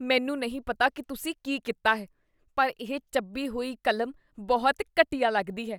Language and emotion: Punjabi, disgusted